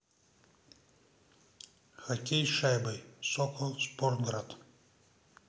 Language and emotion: Russian, neutral